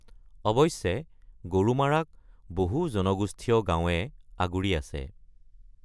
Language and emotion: Assamese, neutral